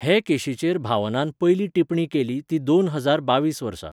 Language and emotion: Goan Konkani, neutral